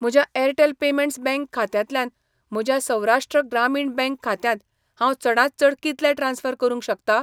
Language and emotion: Goan Konkani, neutral